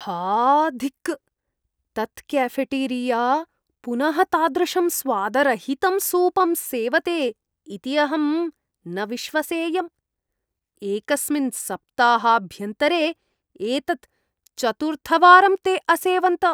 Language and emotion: Sanskrit, disgusted